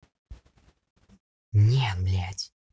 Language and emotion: Russian, angry